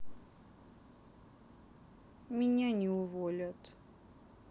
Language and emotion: Russian, sad